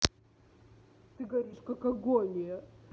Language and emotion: Russian, angry